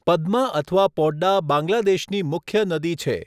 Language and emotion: Gujarati, neutral